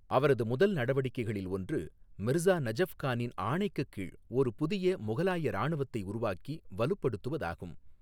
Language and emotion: Tamil, neutral